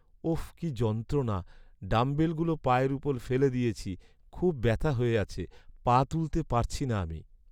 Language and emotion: Bengali, sad